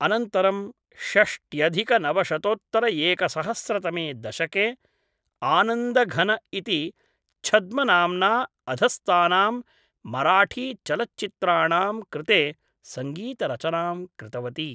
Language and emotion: Sanskrit, neutral